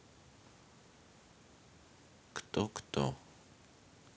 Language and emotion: Russian, sad